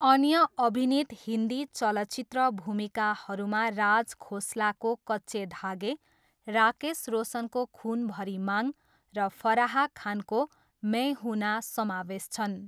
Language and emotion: Nepali, neutral